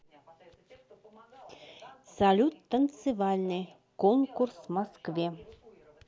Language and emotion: Russian, neutral